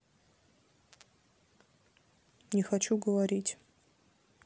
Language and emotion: Russian, sad